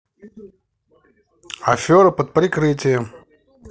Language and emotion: Russian, positive